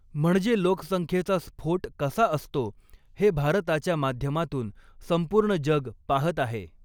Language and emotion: Marathi, neutral